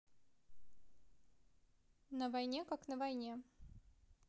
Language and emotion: Russian, neutral